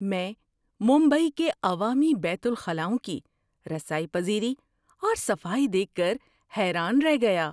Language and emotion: Urdu, surprised